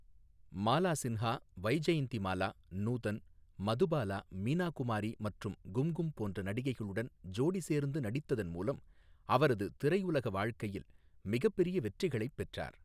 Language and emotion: Tamil, neutral